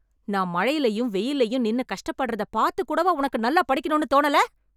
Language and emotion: Tamil, angry